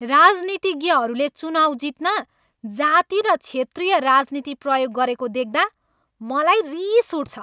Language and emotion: Nepali, angry